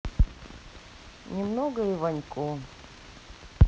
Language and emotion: Russian, neutral